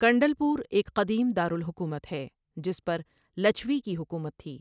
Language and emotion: Urdu, neutral